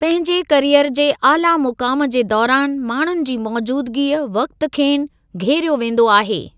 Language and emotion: Sindhi, neutral